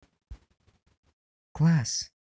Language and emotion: Russian, positive